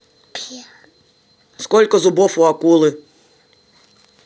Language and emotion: Russian, neutral